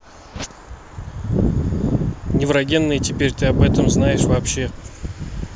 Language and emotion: Russian, neutral